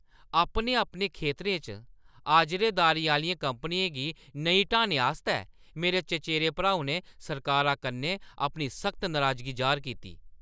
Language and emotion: Dogri, angry